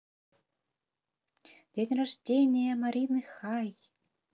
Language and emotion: Russian, positive